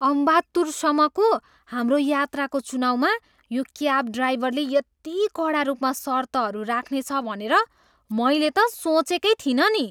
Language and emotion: Nepali, surprised